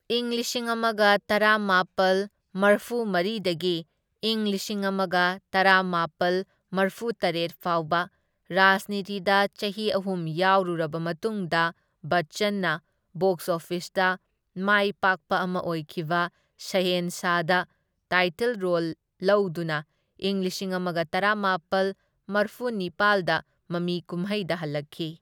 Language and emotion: Manipuri, neutral